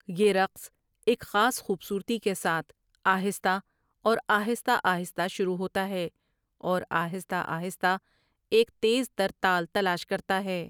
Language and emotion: Urdu, neutral